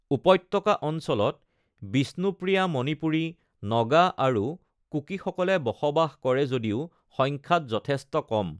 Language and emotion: Assamese, neutral